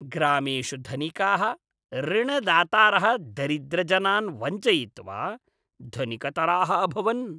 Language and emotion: Sanskrit, disgusted